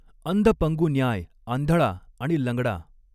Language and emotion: Marathi, neutral